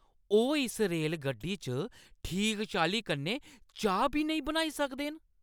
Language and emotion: Dogri, angry